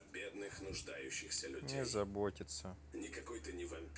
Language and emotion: Russian, sad